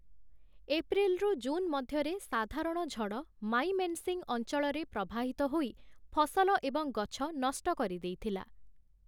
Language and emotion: Odia, neutral